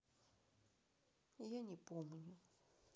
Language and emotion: Russian, sad